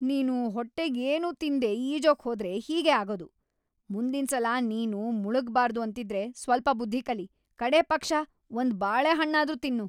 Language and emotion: Kannada, angry